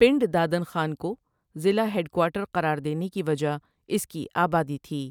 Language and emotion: Urdu, neutral